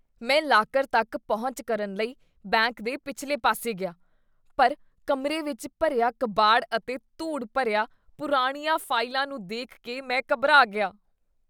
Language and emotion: Punjabi, disgusted